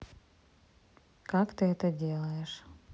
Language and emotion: Russian, neutral